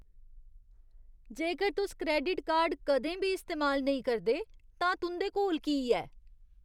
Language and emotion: Dogri, disgusted